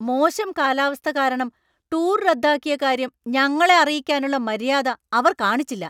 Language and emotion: Malayalam, angry